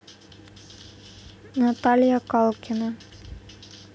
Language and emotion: Russian, neutral